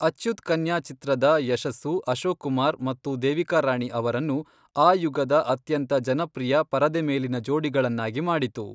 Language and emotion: Kannada, neutral